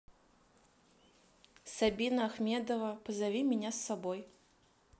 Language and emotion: Russian, neutral